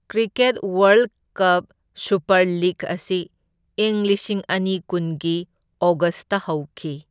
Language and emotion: Manipuri, neutral